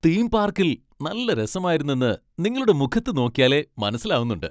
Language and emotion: Malayalam, happy